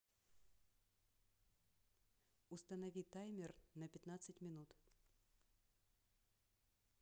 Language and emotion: Russian, neutral